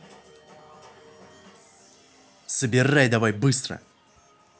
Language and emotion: Russian, angry